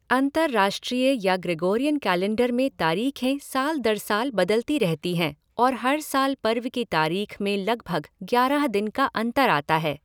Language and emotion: Hindi, neutral